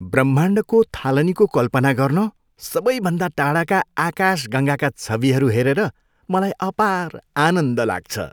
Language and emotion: Nepali, happy